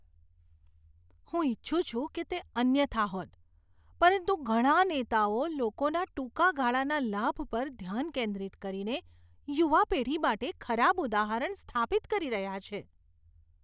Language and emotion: Gujarati, disgusted